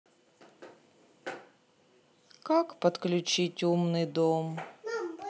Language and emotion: Russian, sad